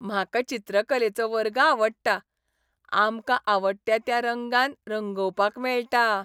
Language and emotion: Goan Konkani, happy